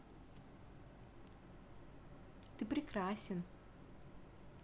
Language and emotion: Russian, positive